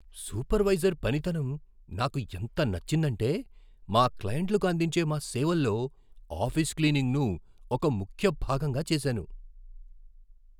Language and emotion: Telugu, surprised